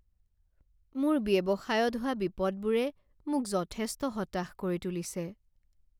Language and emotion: Assamese, sad